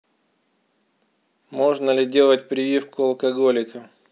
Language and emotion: Russian, neutral